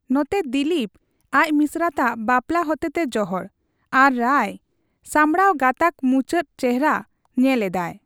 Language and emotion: Santali, neutral